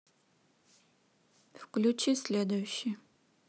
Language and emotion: Russian, neutral